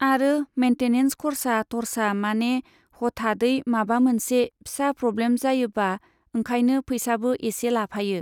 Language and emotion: Bodo, neutral